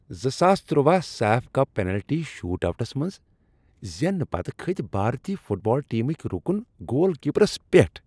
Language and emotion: Kashmiri, happy